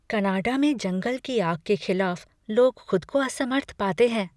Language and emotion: Hindi, fearful